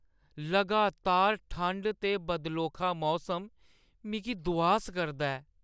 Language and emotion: Dogri, sad